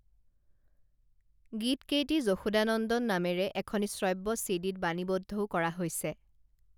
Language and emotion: Assamese, neutral